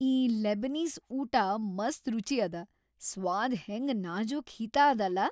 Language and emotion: Kannada, happy